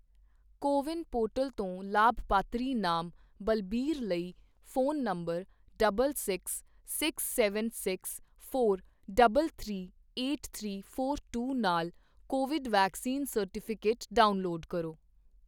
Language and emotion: Punjabi, neutral